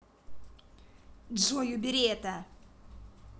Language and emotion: Russian, angry